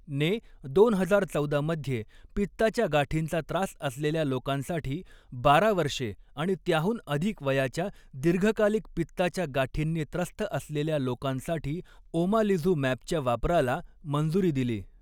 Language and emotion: Marathi, neutral